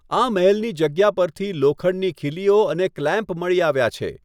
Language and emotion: Gujarati, neutral